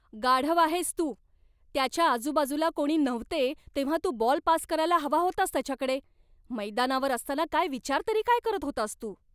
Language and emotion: Marathi, angry